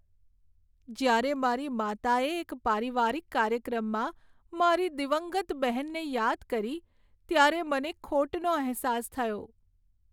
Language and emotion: Gujarati, sad